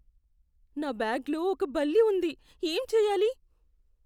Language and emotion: Telugu, fearful